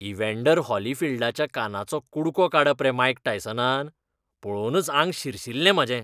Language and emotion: Goan Konkani, disgusted